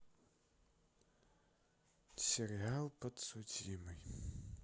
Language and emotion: Russian, sad